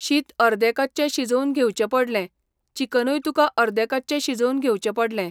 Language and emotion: Goan Konkani, neutral